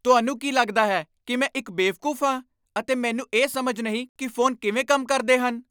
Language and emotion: Punjabi, angry